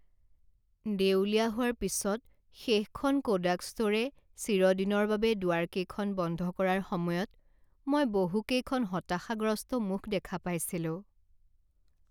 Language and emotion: Assamese, sad